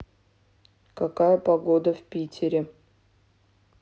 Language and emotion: Russian, neutral